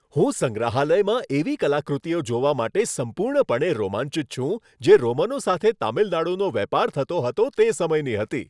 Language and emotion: Gujarati, happy